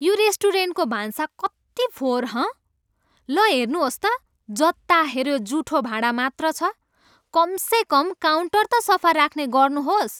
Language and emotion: Nepali, angry